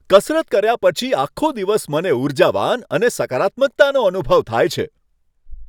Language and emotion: Gujarati, happy